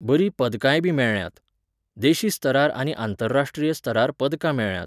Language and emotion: Goan Konkani, neutral